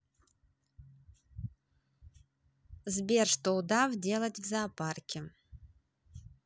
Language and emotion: Russian, neutral